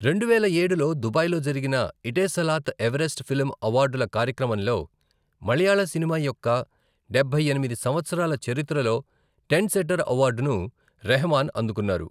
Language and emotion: Telugu, neutral